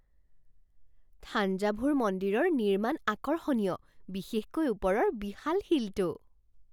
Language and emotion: Assamese, surprised